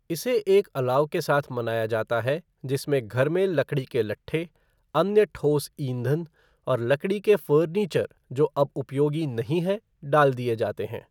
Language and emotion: Hindi, neutral